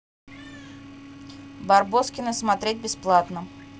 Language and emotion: Russian, neutral